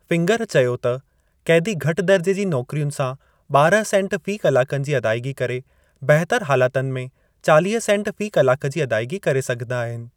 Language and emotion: Sindhi, neutral